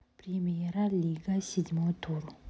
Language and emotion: Russian, neutral